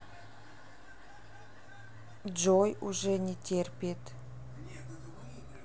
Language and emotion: Russian, neutral